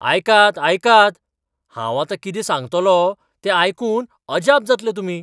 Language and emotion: Goan Konkani, surprised